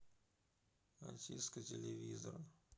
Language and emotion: Russian, neutral